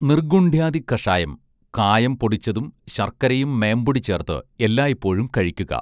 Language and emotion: Malayalam, neutral